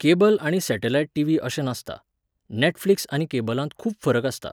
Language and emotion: Goan Konkani, neutral